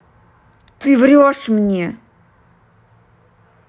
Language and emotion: Russian, angry